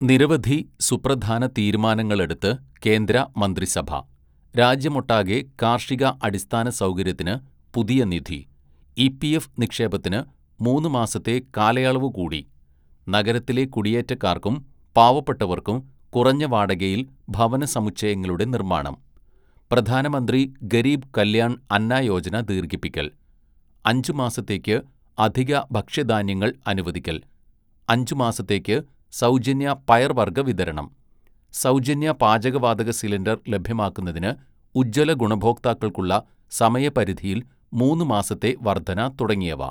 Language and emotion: Malayalam, neutral